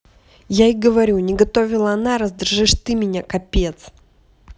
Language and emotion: Russian, angry